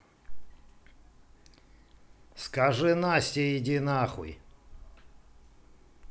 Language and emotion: Russian, angry